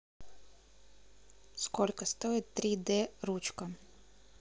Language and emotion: Russian, neutral